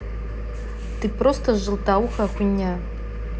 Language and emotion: Russian, angry